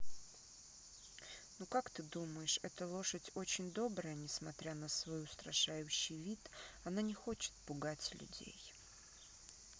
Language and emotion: Russian, neutral